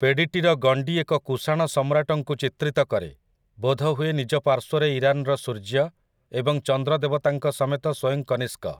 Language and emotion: Odia, neutral